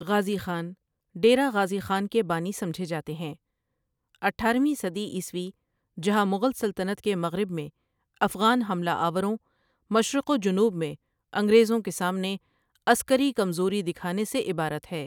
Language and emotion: Urdu, neutral